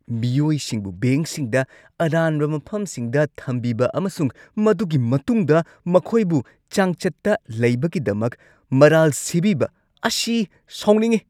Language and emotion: Manipuri, angry